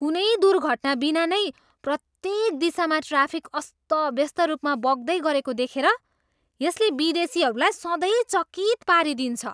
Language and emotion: Nepali, surprised